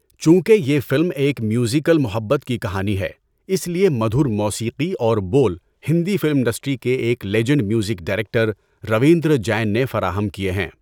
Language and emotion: Urdu, neutral